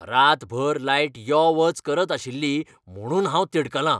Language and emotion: Goan Konkani, angry